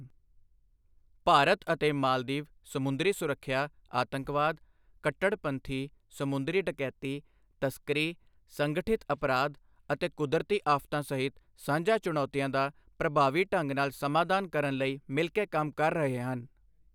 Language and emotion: Punjabi, neutral